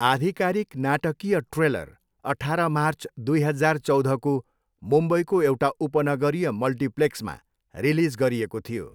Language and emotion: Nepali, neutral